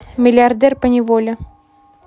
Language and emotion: Russian, neutral